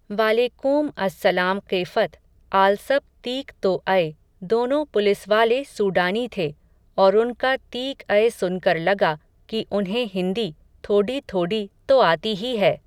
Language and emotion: Hindi, neutral